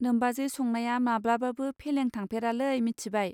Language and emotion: Bodo, neutral